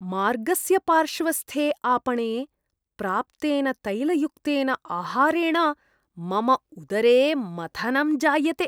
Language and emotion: Sanskrit, disgusted